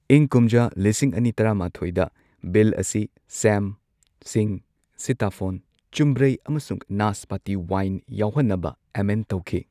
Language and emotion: Manipuri, neutral